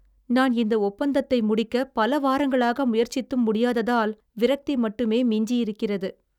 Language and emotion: Tamil, sad